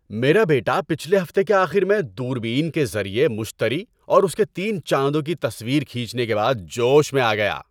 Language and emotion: Urdu, happy